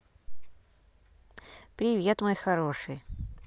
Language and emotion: Russian, positive